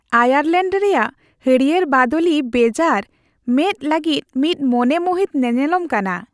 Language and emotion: Santali, happy